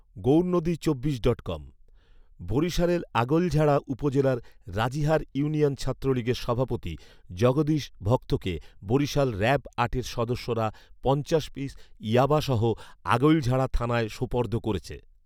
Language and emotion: Bengali, neutral